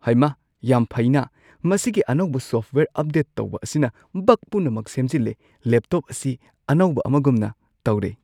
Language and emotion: Manipuri, surprised